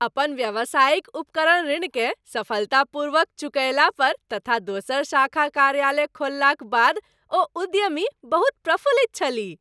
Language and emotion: Maithili, happy